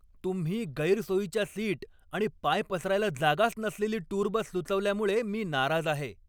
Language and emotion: Marathi, angry